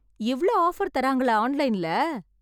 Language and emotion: Tamil, happy